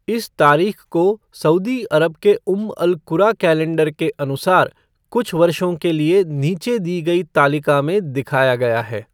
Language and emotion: Hindi, neutral